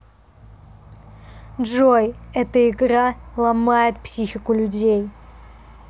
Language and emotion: Russian, neutral